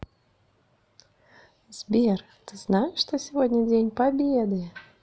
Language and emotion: Russian, positive